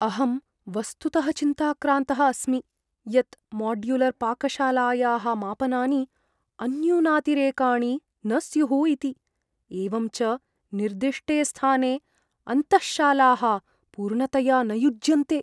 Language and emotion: Sanskrit, fearful